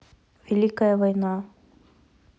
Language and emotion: Russian, neutral